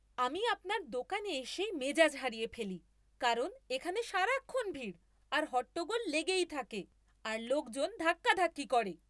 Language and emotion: Bengali, angry